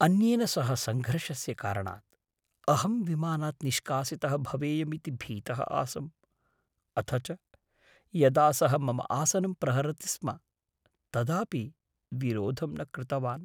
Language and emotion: Sanskrit, fearful